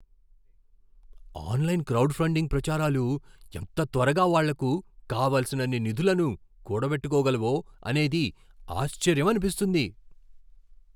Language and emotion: Telugu, surprised